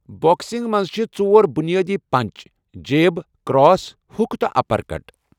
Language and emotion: Kashmiri, neutral